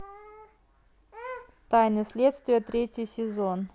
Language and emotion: Russian, neutral